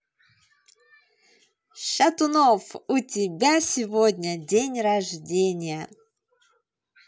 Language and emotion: Russian, positive